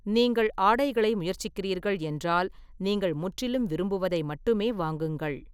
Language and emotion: Tamil, neutral